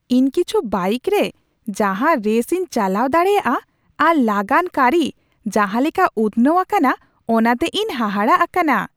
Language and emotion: Santali, surprised